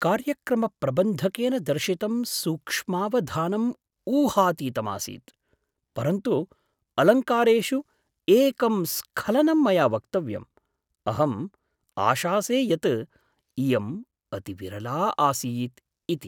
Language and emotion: Sanskrit, surprised